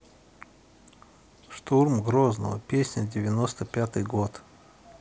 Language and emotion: Russian, neutral